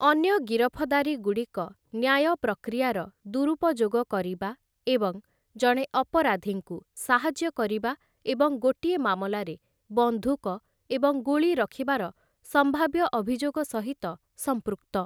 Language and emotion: Odia, neutral